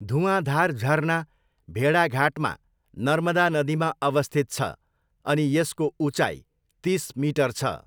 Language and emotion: Nepali, neutral